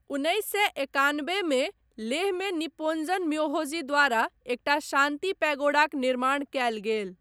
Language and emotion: Maithili, neutral